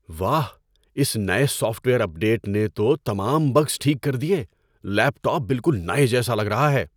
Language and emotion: Urdu, surprised